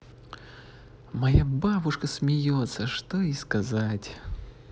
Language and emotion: Russian, positive